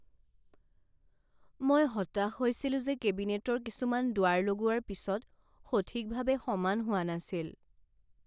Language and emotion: Assamese, sad